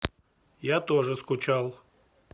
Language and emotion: Russian, neutral